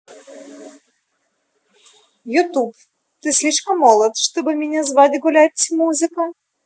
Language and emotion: Russian, positive